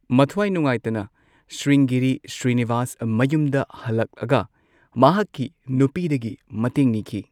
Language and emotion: Manipuri, neutral